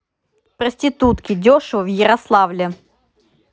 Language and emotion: Russian, neutral